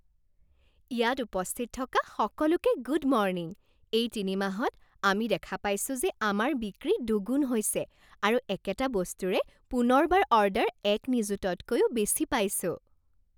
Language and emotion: Assamese, happy